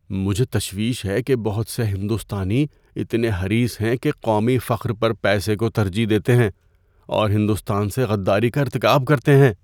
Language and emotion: Urdu, fearful